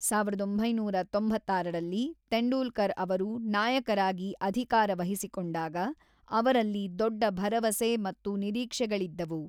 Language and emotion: Kannada, neutral